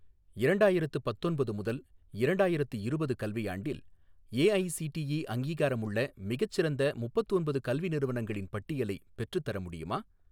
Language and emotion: Tamil, neutral